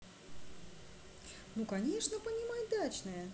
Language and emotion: Russian, positive